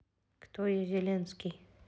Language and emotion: Russian, neutral